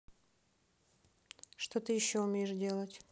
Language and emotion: Russian, neutral